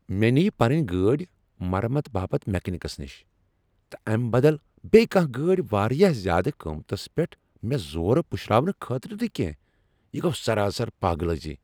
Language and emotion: Kashmiri, angry